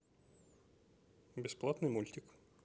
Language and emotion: Russian, neutral